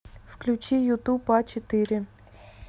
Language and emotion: Russian, neutral